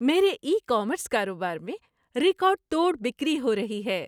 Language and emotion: Urdu, happy